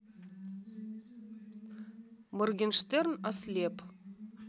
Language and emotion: Russian, neutral